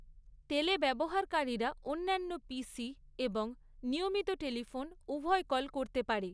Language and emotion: Bengali, neutral